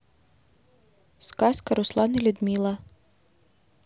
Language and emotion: Russian, neutral